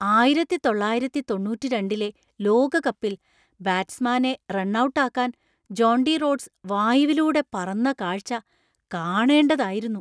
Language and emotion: Malayalam, surprised